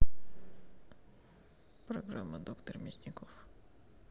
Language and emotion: Russian, neutral